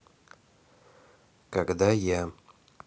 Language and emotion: Russian, neutral